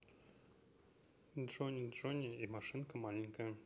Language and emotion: Russian, neutral